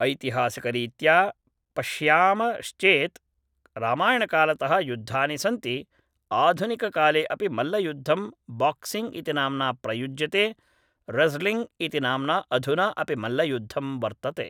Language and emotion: Sanskrit, neutral